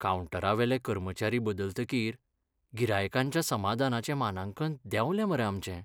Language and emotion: Goan Konkani, sad